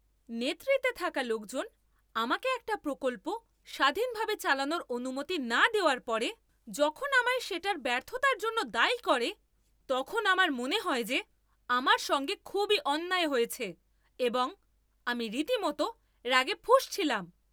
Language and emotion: Bengali, angry